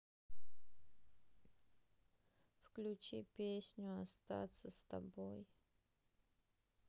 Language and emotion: Russian, sad